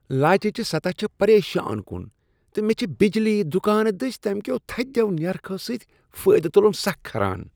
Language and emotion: Kashmiri, disgusted